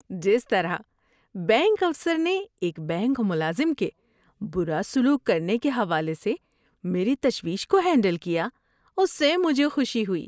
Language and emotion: Urdu, happy